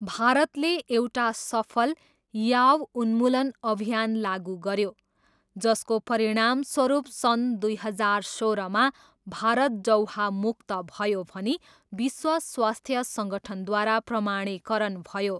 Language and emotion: Nepali, neutral